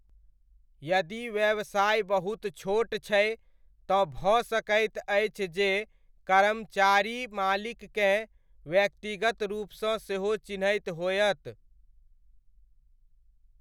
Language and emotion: Maithili, neutral